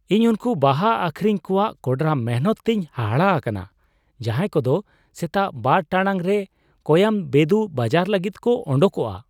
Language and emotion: Santali, surprised